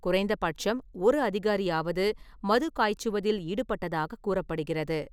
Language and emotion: Tamil, neutral